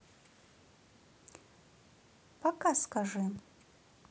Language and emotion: Russian, neutral